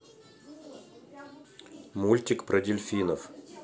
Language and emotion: Russian, neutral